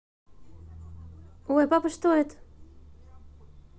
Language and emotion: Russian, positive